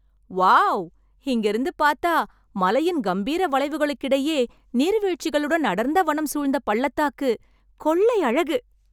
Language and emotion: Tamil, happy